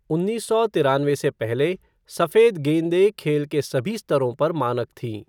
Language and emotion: Hindi, neutral